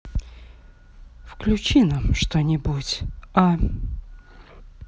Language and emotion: Russian, sad